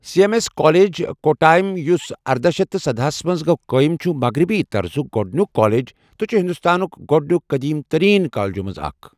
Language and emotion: Kashmiri, neutral